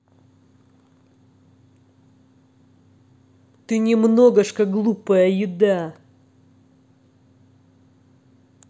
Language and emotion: Russian, angry